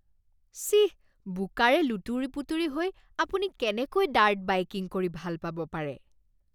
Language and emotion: Assamese, disgusted